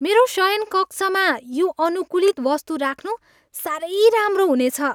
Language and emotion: Nepali, happy